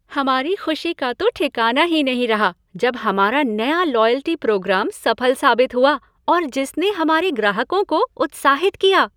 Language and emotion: Hindi, happy